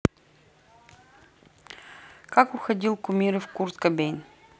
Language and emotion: Russian, neutral